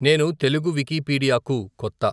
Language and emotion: Telugu, neutral